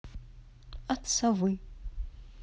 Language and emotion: Russian, neutral